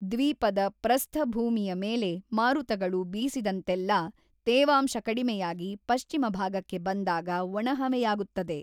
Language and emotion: Kannada, neutral